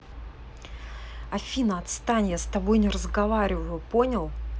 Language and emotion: Russian, angry